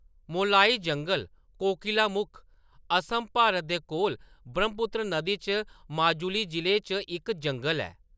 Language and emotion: Dogri, neutral